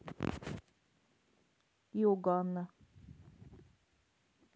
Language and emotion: Russian, neutral